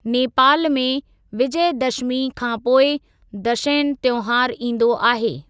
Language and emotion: Sindhi, neutral